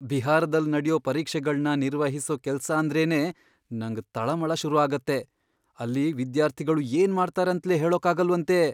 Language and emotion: Kannada, fearful